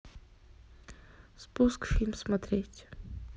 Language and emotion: Russian, neutral